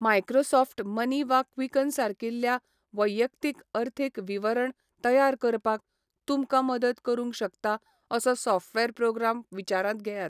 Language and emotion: Goan Konkani, neutral